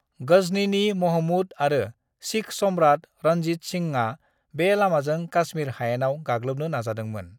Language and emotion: Bodo, neutral